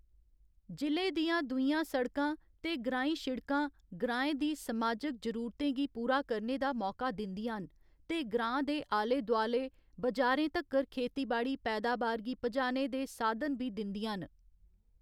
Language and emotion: Dogri, neutral